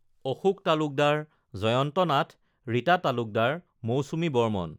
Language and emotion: Assamese, neutral